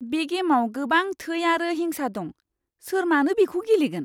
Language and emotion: Bodo, disgusted